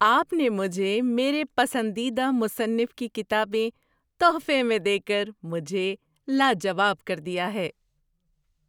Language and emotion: Urdu, surprised